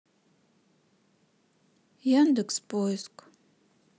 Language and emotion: Russian, sad